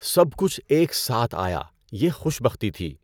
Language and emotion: Urdu, neutral